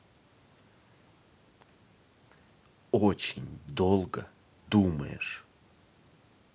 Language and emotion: Russian, angry